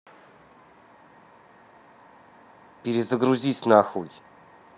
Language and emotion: Russian, angry